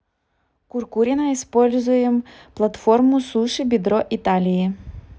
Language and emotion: Russian, neutral